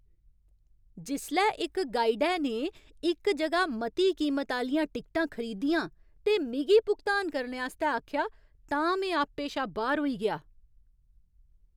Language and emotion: Dogri, angry